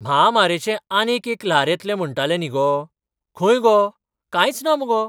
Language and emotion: Goan Konkani, surprised